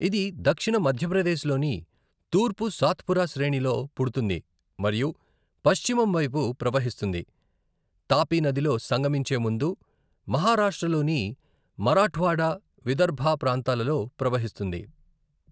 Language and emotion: Telugu, neutral